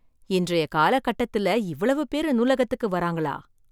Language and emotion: Tamil, surprised